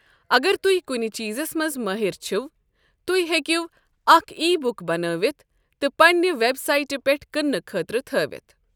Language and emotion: Kashmiri, neutral